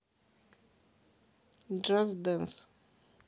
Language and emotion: Russian, neutral